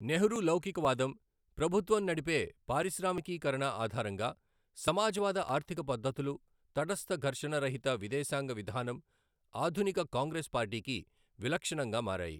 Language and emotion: Telugu, neutral